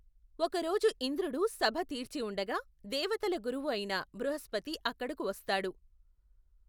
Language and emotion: Telugu, neutral